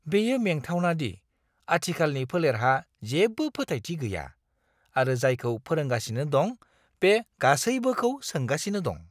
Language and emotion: Bodo, disgusted